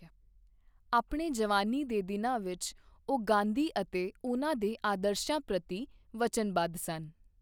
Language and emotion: Punjabi, neutral